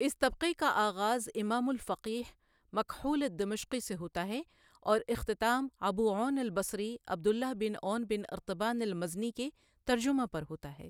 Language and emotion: Urdu, neutral